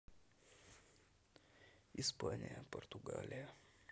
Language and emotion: Russian, neutral